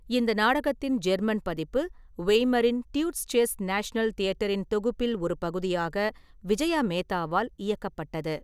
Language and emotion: Tamil, neutral